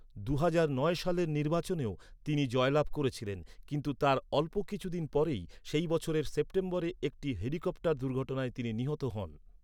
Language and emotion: Bengali, neutral